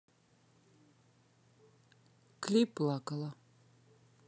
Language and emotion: Russian, neutral